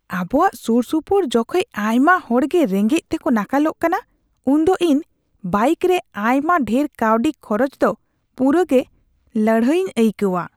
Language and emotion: Santali, disgusted